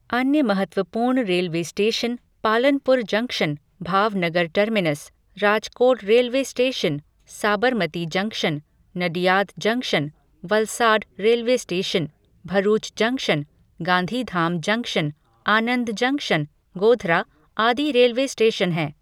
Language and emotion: Hindi, neutral